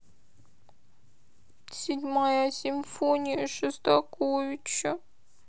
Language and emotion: Russian, sad